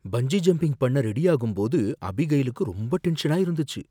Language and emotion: Tamil, fearful